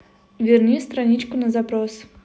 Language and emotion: Russian, neutral